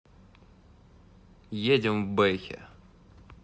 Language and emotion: Russian, neutral